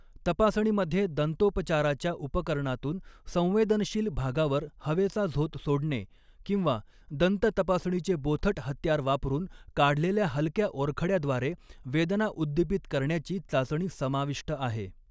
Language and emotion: Marathi, neutral